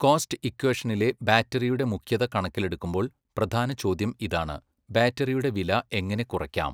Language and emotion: Malayalam, neutral